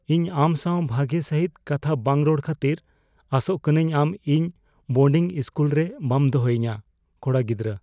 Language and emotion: Santali, fearful